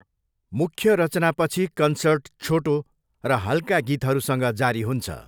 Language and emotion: Nepali, neutral